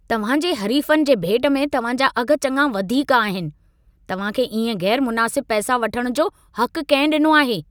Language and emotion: Sindhi, angry